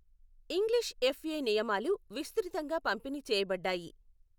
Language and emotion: Telugu, neutral